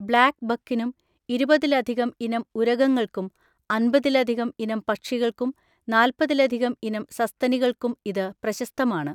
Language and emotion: Malayalam, neutral